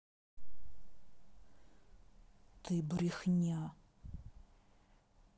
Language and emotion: Russian, angry